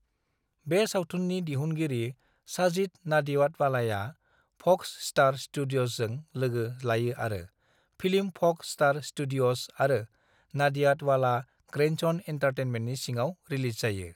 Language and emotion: Bodo, neutral